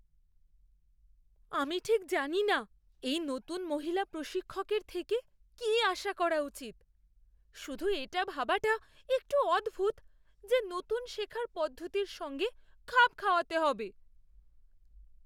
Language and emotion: Bengali, fearful